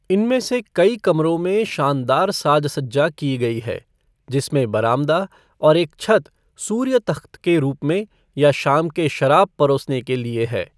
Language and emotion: Hindi, neutral